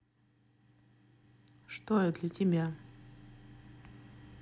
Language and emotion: Russian, neutral